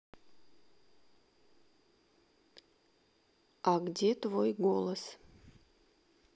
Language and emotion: Russian, neutral